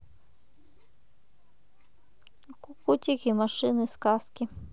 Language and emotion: Russian, neutral